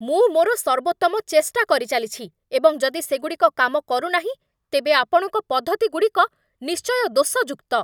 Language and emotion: Odia, angry